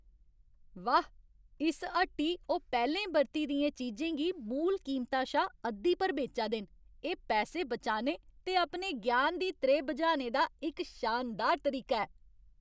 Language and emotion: Dogri, happy